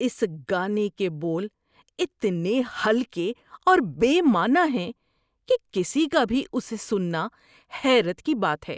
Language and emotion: Urdu, disgusted